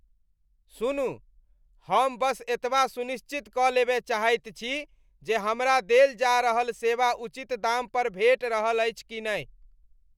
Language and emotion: Maithili, disgusted